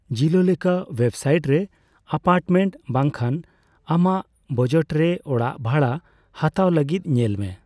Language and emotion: Santali, neutral